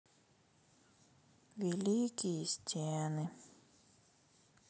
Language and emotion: Russian, sad